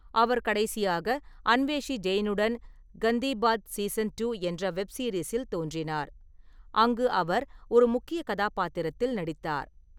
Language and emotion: Tamil, neutral